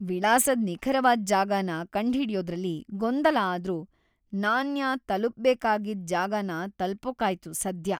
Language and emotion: Kannada, happy